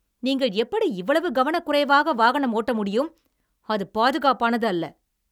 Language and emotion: Tamil, angry